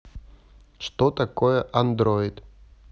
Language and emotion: Russian, neutral